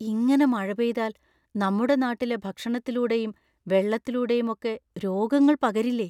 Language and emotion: Malayalam, fearful